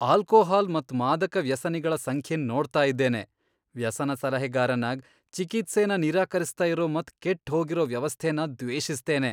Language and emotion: Kannada, disgusted